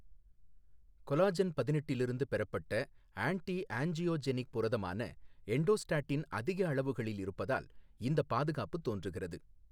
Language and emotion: Tamil, neutral